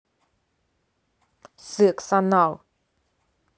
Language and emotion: Russian, angry